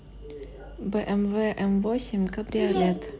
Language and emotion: Russian, neutral